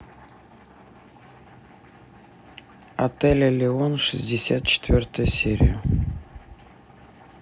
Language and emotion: Russian, neutral